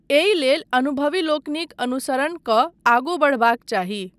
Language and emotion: Maithili, neutral